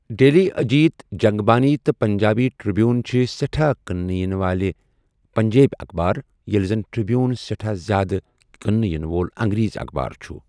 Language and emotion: Kashmiri, neutral